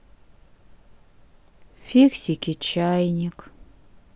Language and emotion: Russian, sad